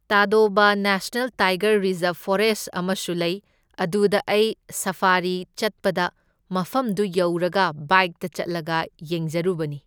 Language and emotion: Manipuri, neutral